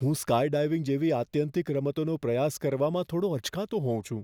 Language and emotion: Gujarati, fearful